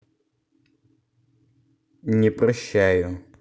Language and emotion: Russian, neutral